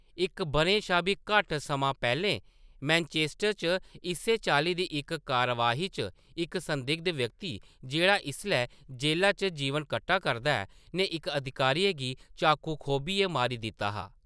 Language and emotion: Dogri, neutral